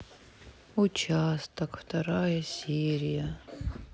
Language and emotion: Russian, sad